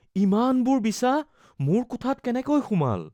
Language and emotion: Assamese, fearful